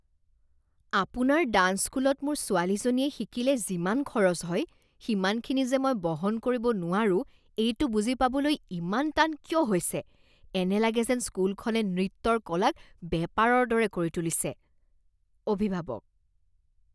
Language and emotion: Assamese, disgusted